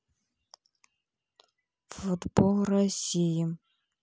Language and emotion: Russian, neutral